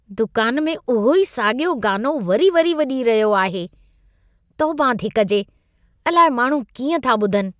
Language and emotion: Sindhi, disgusted